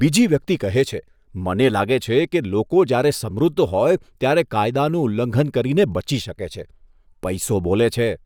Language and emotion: Gujarati, disgusted